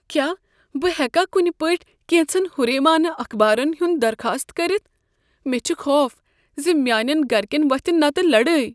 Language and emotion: Kashmiri, fearful